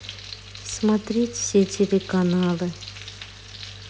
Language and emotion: Russian, neutral